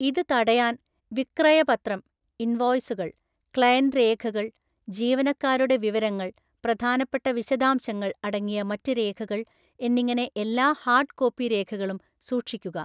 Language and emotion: Malayalam, neutral